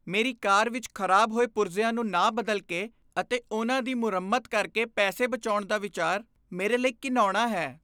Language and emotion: Punjabi, disgusted